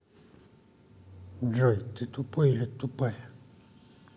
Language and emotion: Russian, angry